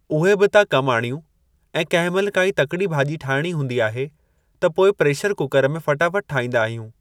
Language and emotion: Sindhi, neutral